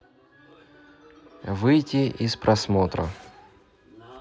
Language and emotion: Russian, neutral